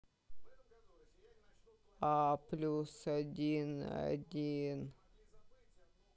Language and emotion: Russian, sad